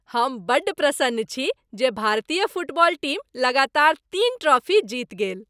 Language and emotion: Maithili, happy